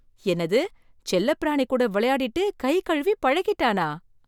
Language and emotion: Tamil, surprised